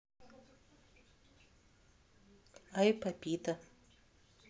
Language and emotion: Russian, neutral